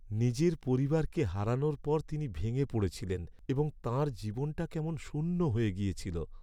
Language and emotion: Bengali, sad